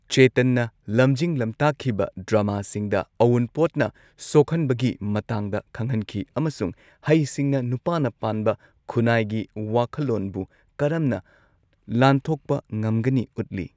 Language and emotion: Manipuri, neutral